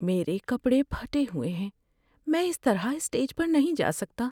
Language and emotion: Urdu, sad